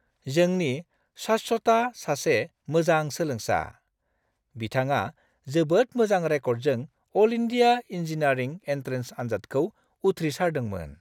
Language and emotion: Bodo, happy